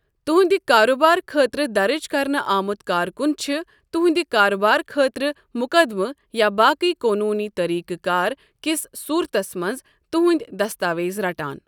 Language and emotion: Kashmiri, neutral